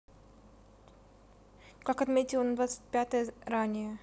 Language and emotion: Russian, neutral